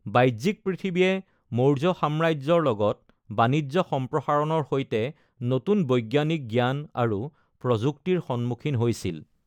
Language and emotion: Assamese, neutral